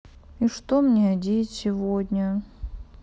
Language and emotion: Russian, sad